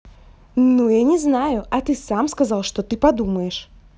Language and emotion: Russian, angry